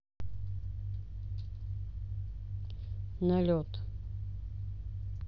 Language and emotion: Russian, neutral